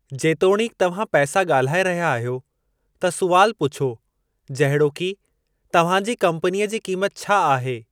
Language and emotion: Sindhi, neutral